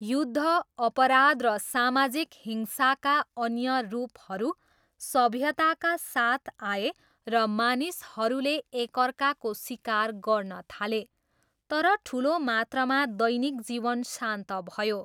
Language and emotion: Nepali, neutral